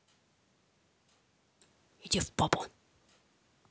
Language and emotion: Russian, angry